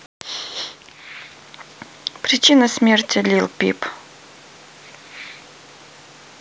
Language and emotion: Russian, neutral